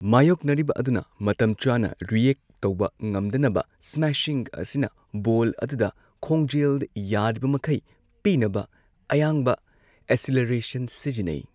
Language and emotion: Manipuri, neutral